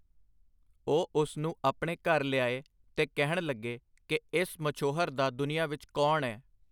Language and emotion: Punjabi, neutral